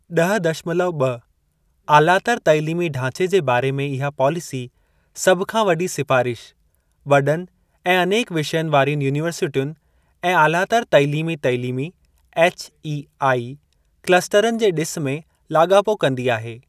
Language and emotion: Sindhi, neutral